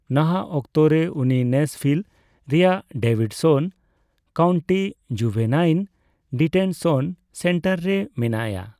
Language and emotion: Santali, neutral